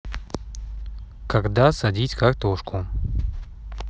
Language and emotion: Russian, neutral